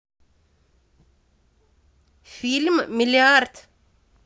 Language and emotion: Russian, neutral